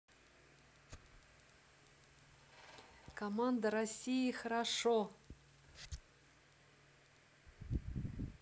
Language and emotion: Russian, positive